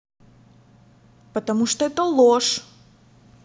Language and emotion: Russian, angry